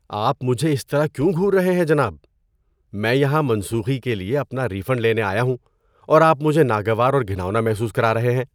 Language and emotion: Urdu, disgusted